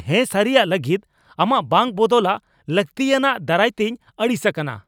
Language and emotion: Santali, angry